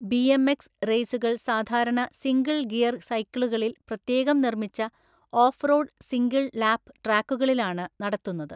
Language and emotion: Malayalam, neutral